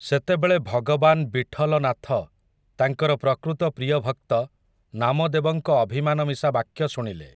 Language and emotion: Odia, neutral